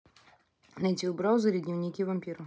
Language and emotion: Russian, neutral